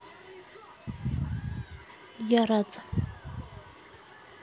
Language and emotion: Russian, neutral